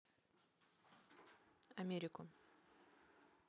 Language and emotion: Russian, neutral